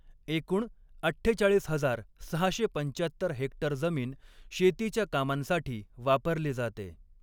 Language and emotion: Marathi, neutral